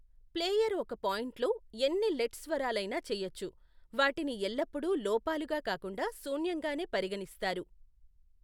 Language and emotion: Telugu, neutral